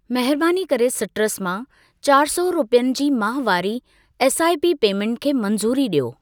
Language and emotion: Sindhi, neutral